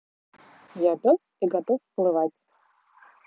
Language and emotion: Russian, positive